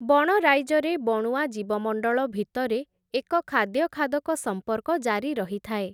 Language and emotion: Odia, neutral